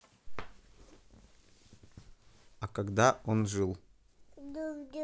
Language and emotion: Russian, neutral